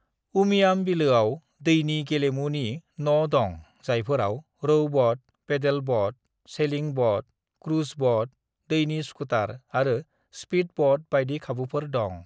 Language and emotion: Bodo, neutral